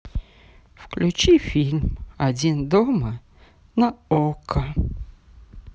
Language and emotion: Russian, sad